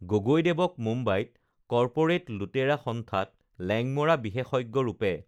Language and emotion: Assamese, neutral